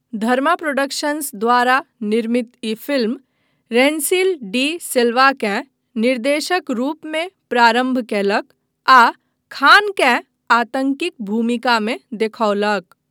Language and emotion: Maithili, neutral